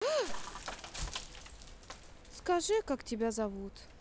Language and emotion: Russian, sad